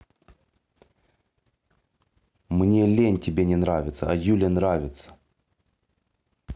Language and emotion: Russian, angry